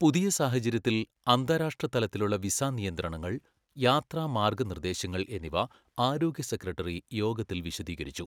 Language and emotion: Malayalam, neutral